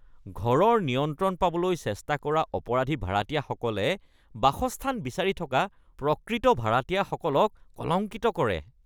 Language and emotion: Assamese, disgusted